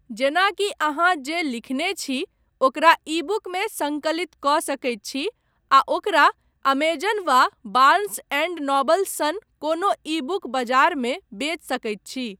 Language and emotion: Maithili, neutral